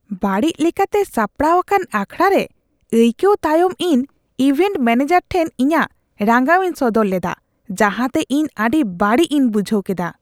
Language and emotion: Santali, disgusted